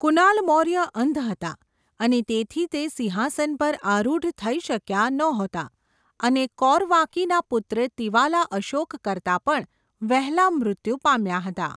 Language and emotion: Gujarati, neutral